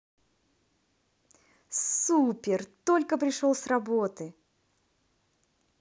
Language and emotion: Russian, positive